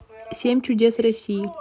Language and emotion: Russian, neutral